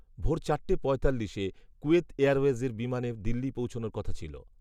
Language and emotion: Bengali, neutral